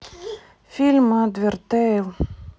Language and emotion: Russian, sad